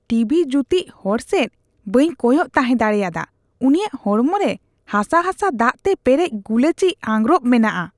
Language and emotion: Santali, disgusted